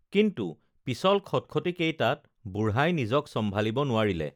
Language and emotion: Assamese, neutral